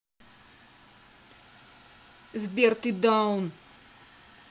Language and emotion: Russian, angry